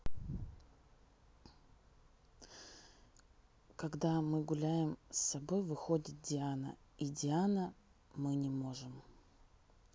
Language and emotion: Russian, neutral